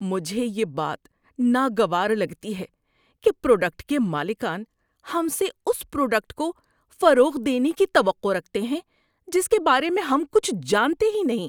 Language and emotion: Urdu, disgusted